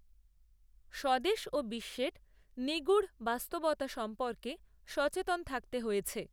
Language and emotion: Bengali, neutral